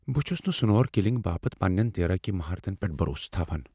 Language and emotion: Kashmiri, fearful